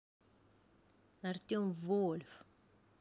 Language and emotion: Russian, neutral